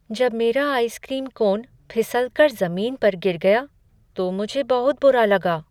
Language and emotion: Hindi, sad